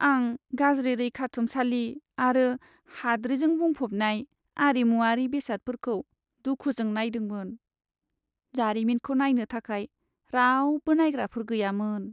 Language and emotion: Bodo, sad